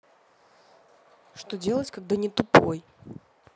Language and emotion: Russian, neutral